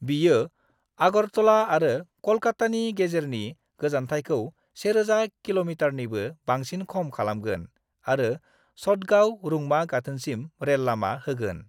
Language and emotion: Bodo, neutral